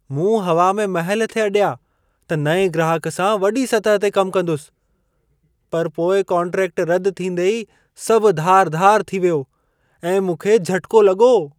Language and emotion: Sindhi, surprised